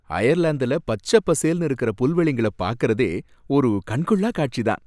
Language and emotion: Tamil, happy